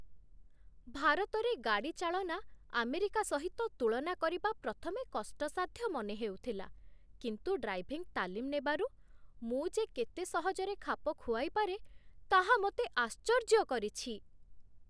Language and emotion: Odia, surprised